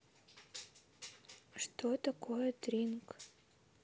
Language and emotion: Russian, neutral